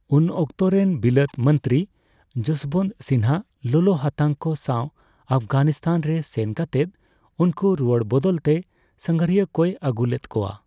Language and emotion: Santali, neutral